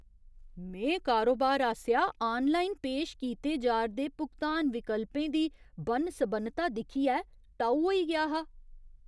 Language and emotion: Dogri, surprised